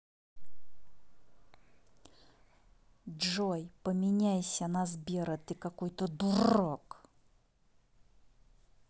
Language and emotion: Russian, angry